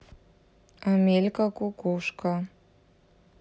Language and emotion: Russian, neutral